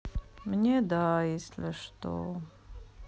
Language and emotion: Russian, sad